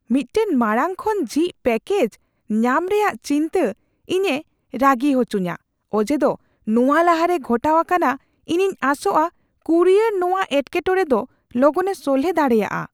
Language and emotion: Santali, fearful